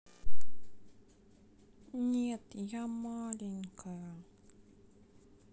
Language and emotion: Russian, sad